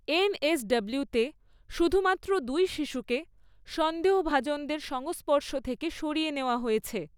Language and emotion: Bengali, neutral